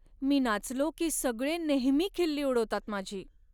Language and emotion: Marathi, sad